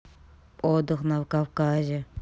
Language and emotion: Russian, neutral